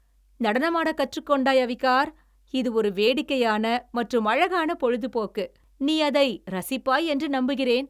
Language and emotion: Tamil, happy